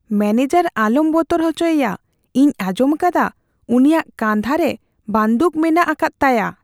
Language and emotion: Santali, fearful